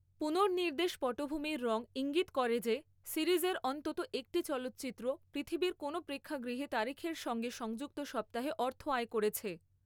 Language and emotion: Bengali, neutral